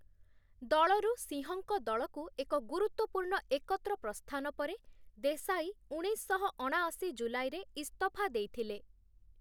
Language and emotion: Odia, neutral